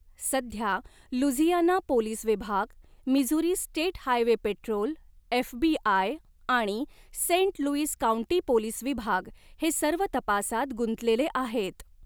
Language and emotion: Marathi, neutral